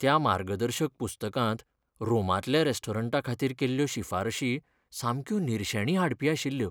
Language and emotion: Goan Konkani, sad